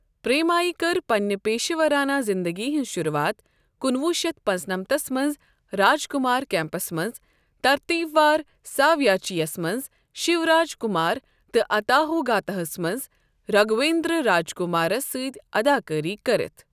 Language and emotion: Kashmiri, neutral